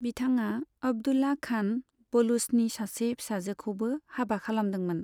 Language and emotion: Bodo, neutral